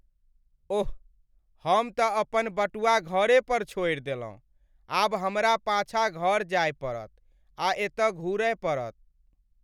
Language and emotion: Maithili, sad